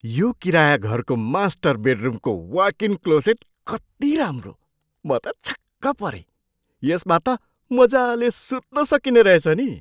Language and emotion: Nepali, surprised